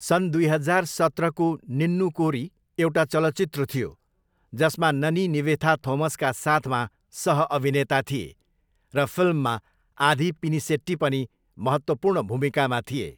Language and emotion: Nepali, neutral